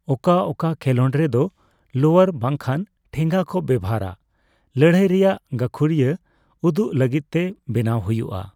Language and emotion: Santali, neutral